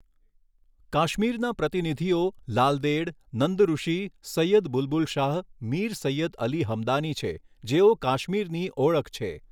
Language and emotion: Gujarati, neutral